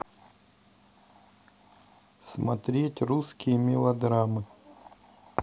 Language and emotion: Russian, neutral